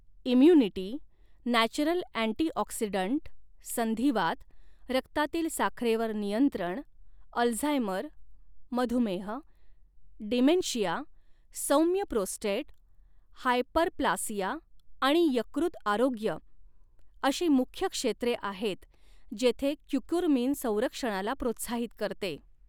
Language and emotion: Marathi, neutral